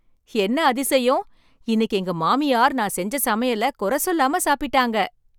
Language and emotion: Tamil, surprised